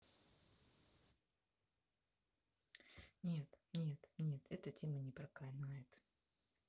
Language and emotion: Russian, sad